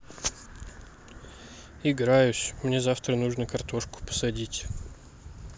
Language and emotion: Russian, sad